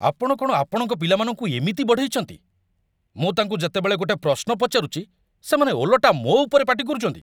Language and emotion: Odia, angry